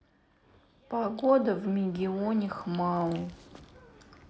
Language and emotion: Russian, sad